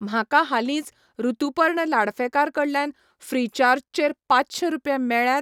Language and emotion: Goan Konkani, neutral